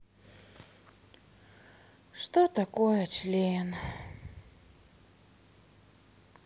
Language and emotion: Russian, sad